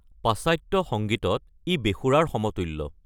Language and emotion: Assamese, neutral